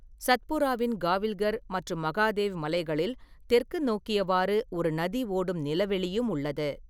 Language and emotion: Tamil, neutral